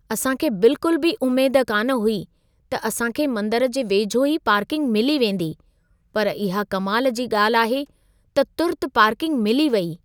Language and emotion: Sindhi, surprised